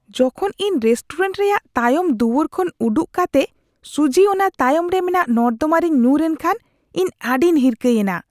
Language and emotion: Santali, disgusted